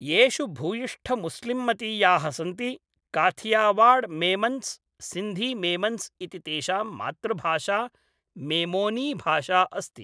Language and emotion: Sanskrit, neutral